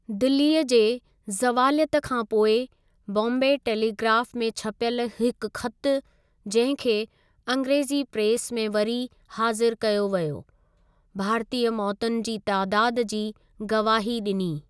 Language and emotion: Sindhi, neutral